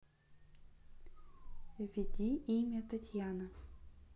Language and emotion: Russian, neutral